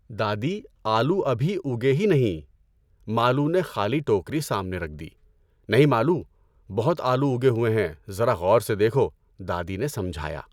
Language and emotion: Urdu, neutral